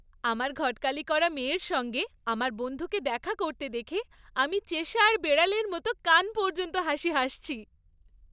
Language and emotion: Bengali, happy